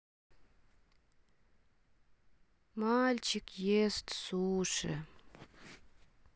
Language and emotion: Russian, sad